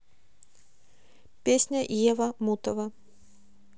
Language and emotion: Russian, neutral